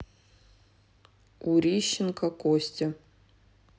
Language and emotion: Russian, neutral